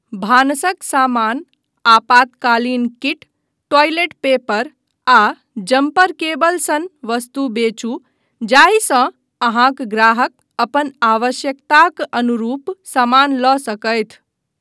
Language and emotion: Maithili, neutral